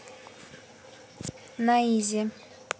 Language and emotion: Russian, neutral